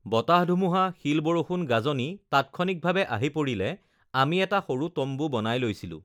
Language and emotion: Assamese, neutral